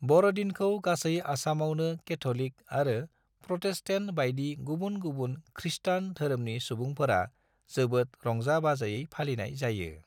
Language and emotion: Bodo, neutral